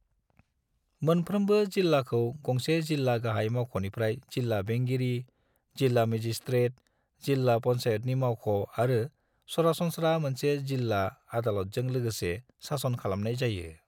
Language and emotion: Bodo, neutral